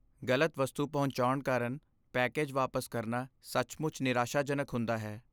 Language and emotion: Punjabi, sad